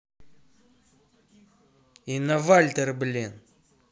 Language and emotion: Russian, angry